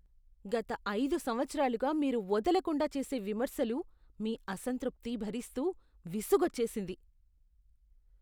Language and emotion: Telugu, disgusted